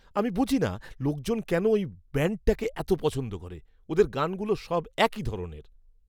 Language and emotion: Bengali, disgusted